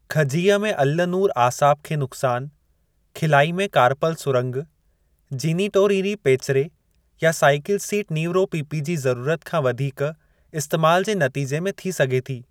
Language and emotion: Sindhi, neutral